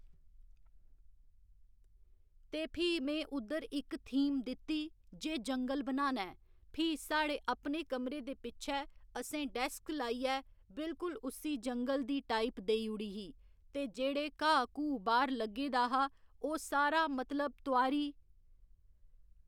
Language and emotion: Dogri, neutral